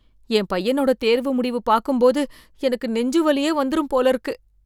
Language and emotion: Tamil, fearful